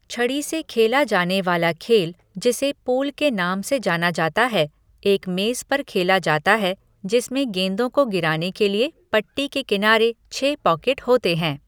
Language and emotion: Hindi, neutral